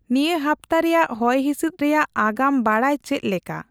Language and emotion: Santali, neutral